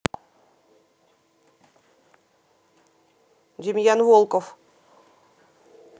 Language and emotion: Russian, neutral